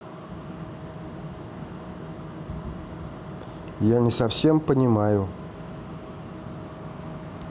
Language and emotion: Russian, neutral